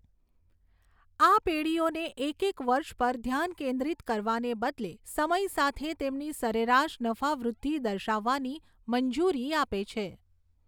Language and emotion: Gujarati, neutral